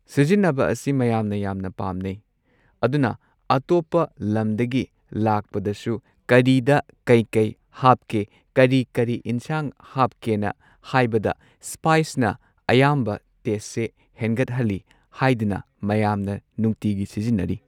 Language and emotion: Manipuri, neutral